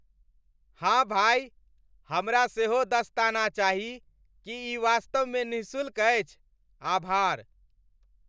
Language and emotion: Maithili, happy